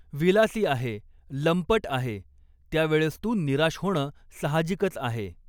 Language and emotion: Marathi, neutral